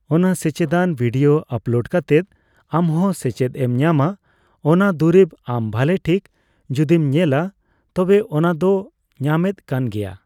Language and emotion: Santali, neutral